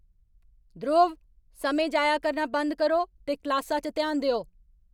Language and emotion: Dogri, angry